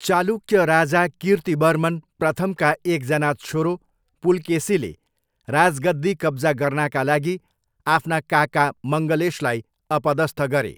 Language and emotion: Nepali, neutral